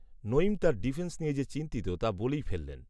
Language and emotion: Bengali, neutral